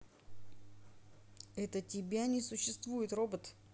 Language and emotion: Russian, neutral